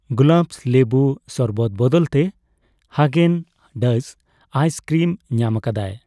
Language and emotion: Santali, neutral